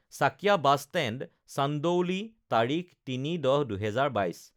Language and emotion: Assamese, neutral